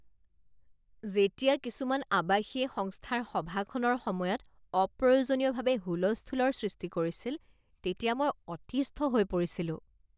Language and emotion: Assamese, disgusted